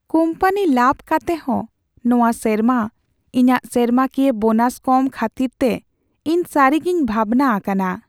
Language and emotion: Santali, sad